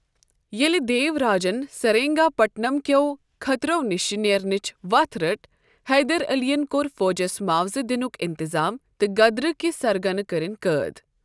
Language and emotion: Kashmiri, neutral